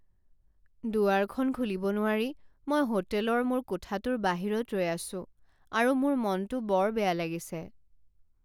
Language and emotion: Assamese, sad